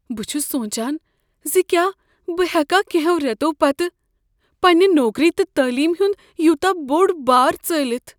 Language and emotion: Kashmiri, fearful